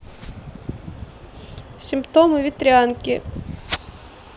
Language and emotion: Russian, neutral